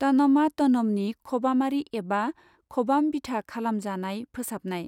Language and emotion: Bodo, neutral